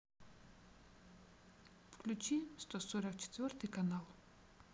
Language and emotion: Russian, neutral